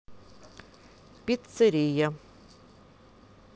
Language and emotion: Russian, neutral